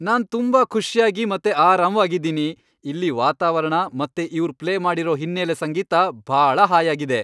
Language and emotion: Kannada, happy